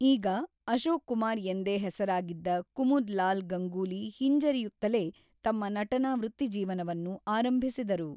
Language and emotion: Kannada, neutral